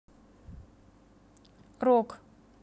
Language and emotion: Russian, neutral